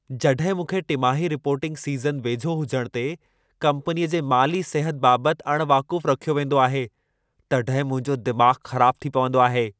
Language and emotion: Sindhi, angry